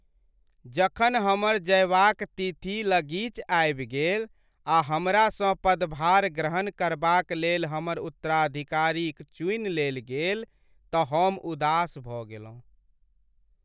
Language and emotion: Maithili, sad